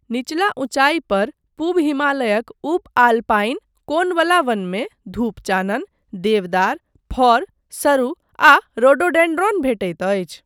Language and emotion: Maithili, neutral